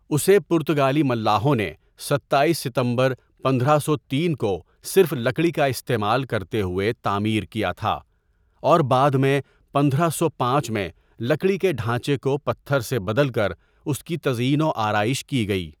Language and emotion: Urdu, neutral